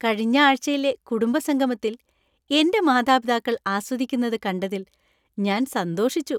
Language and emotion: Malayalam, happy